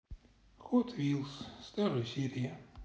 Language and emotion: Russian, neutral